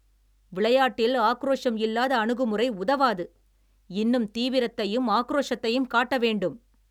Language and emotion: Tamil, angry